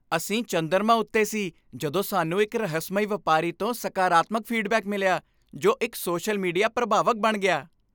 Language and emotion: Punjabi, happy